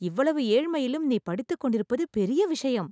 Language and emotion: Tamil, surprised